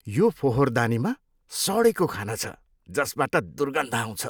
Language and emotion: Nepali, disgusted